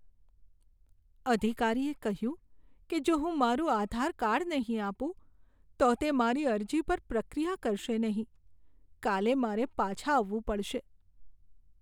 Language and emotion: Gujarati, sad